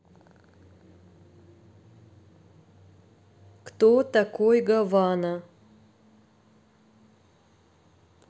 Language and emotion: Russian, neutral